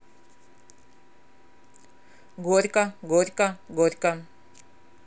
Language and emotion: Russian, neutral